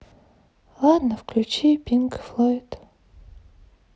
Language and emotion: Russian, sad